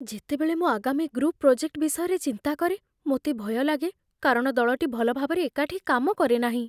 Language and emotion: Odia, fearful